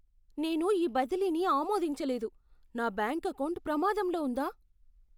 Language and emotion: Telugu, fearful